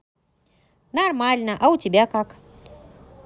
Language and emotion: Russian, positive